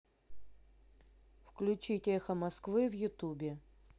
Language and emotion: Russian, neutral